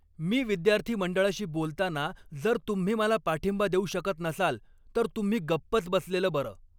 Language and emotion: Marathi, angry